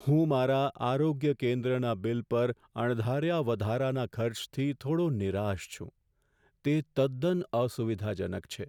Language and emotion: Gujarati, sad